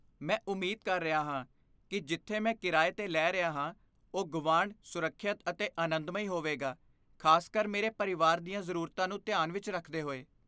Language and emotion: Punjabi, fearful